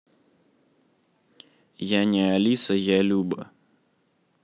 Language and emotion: Russian, neutral